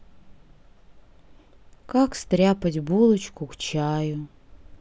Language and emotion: Russian, sad